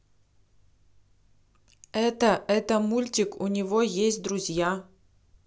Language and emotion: Russian, neutral